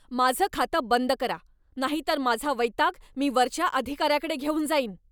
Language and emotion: Marathi, angry